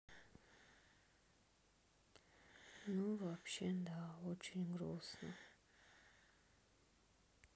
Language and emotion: Russian, sad